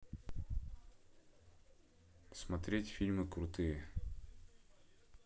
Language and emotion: Russian, neutral